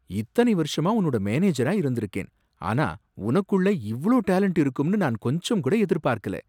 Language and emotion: Tamil, surprised